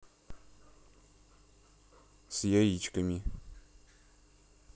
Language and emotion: Russian, neutral